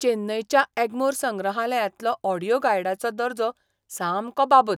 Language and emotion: Goan Konkani, disgusted